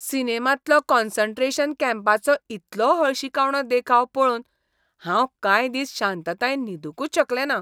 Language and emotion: Goan Konkani, disgusted